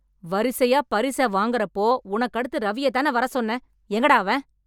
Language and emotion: Tamil, angry